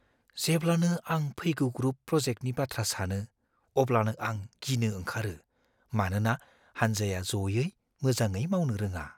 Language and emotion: Bodo, fearful